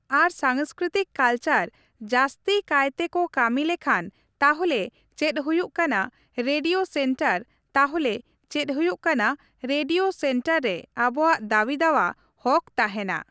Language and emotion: Santali, neutral